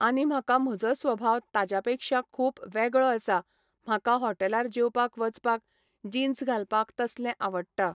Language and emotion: Goan Konkani, neutral